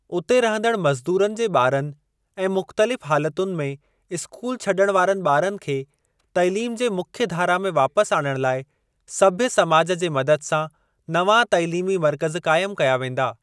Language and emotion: Sindhi, neutral